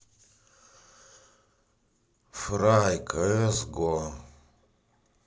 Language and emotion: Russian, sad